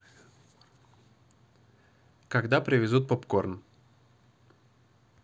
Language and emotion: Russian, neutral